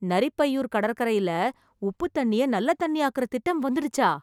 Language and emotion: Tamil, surprised